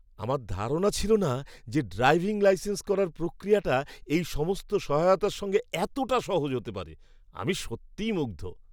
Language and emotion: Bengali, surprised